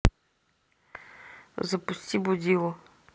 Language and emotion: Russian, neutral